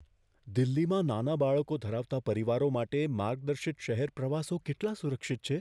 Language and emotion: Gujarati, fearful